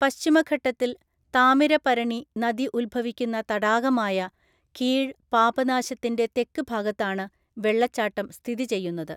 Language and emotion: Malayalam, neutral